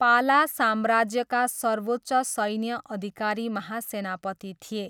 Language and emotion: Nepali, neutral